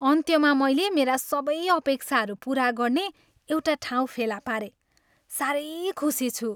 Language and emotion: Nepali, happy